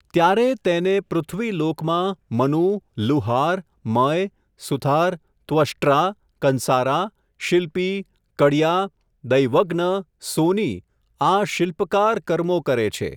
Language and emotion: Gujarati, neutral